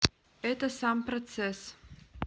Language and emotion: Russian, neutral